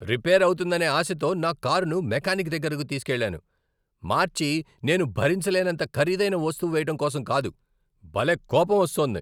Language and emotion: Telugu, angry